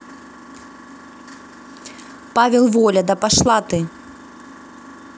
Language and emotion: Russian, angry